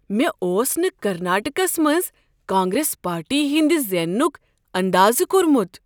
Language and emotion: Kashmiri, surprised